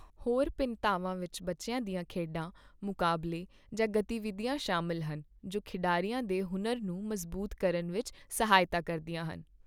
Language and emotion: Punjabi, neutral